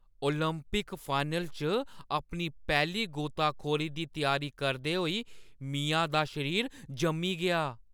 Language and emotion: Dogri, fearful